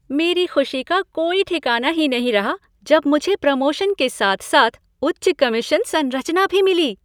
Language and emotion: Hindi, happy